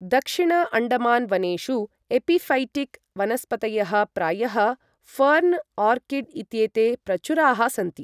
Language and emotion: Sanskrit, neutral